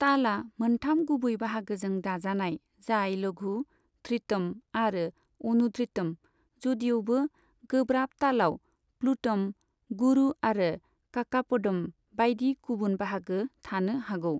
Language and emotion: Bodo, neutral